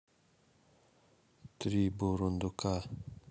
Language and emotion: Russian, neutral